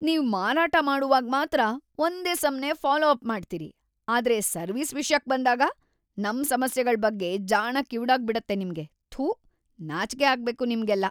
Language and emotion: Kannada, disgusted